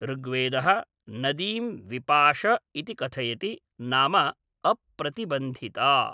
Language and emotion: Sanskrit, neutral